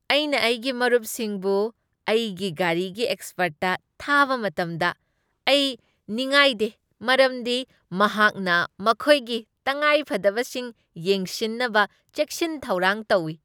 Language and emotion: Manipuri, happy